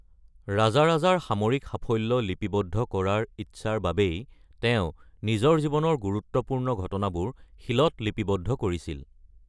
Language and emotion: Assamese, neutral